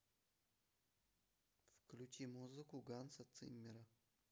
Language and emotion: Russian, neutral